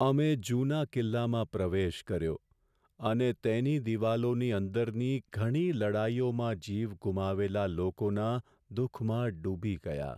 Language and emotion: Gujarati, sad